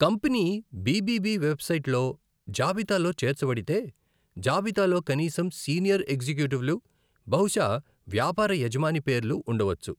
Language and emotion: Telugu, neutral